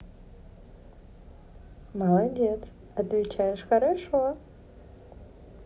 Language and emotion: Russian, positive